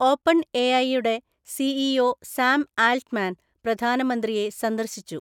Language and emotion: Malayalam, neutral